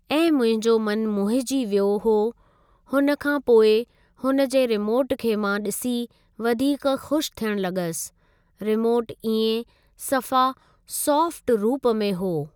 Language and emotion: Sindhi, neutral